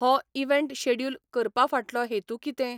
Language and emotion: Goan Konkani, neutral